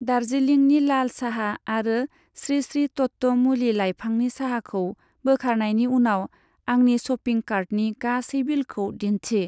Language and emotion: Bodo, neutral